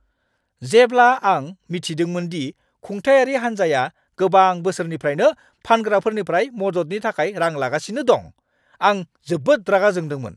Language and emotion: Bodo, angry